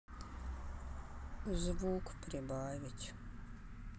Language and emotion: Russian, sad